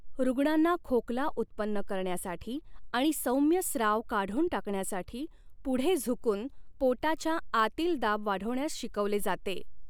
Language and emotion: Marathi, neutral